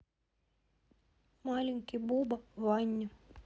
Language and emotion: Russian, neutral